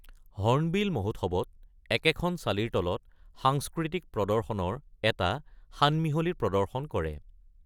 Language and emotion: Assamese, neutral